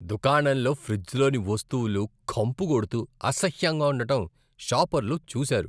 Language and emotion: Telugu, disgusted